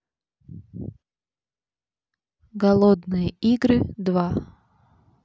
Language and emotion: Russian, neutral